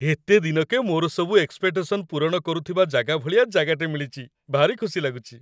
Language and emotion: Odia, happy